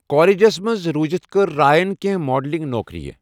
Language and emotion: Kashmiri, neutral